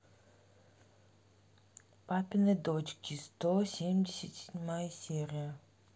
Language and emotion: Russian, neutral